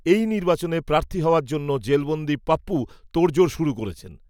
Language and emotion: Bengali, neutral